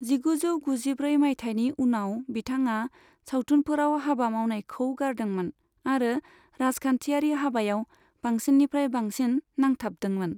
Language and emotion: Bodo, neutral